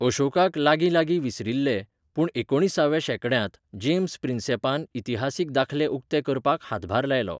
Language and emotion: Goan Konkani, neutral